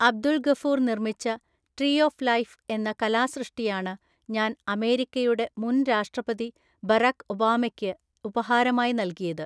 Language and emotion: Malayalam, neutral